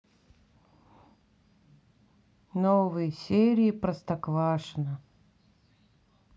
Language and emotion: Russian, sad